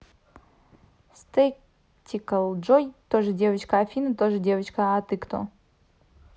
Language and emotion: Russian, neutral